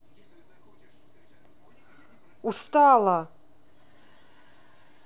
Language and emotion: Russian, angry